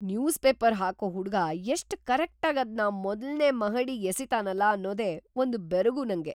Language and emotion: Kannada, surprised